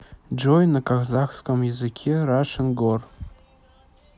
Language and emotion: Russian, neutral